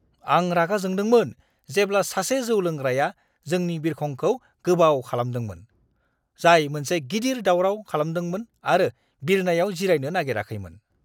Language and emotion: Bodo, angry